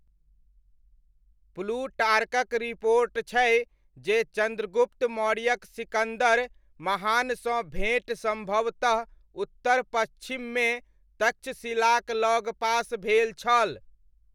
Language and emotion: Maithili, neutral